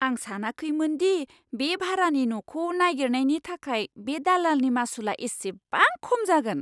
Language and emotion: Bodo, surprised